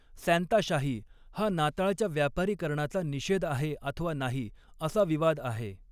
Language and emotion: Marathi, neutral